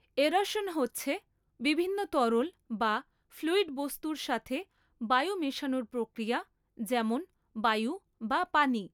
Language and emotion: Bengali, neutral